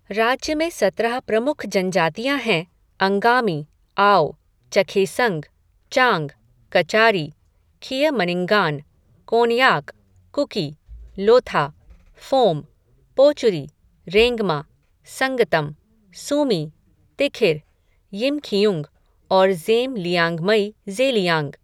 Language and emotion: Hindi, neutral